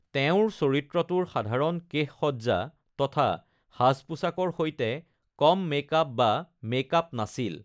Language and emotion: Assamese, neutral